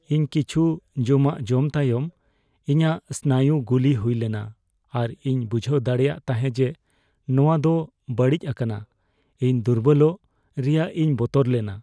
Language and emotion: Santali, fearful